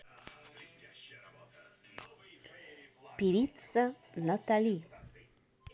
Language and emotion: Russian, positive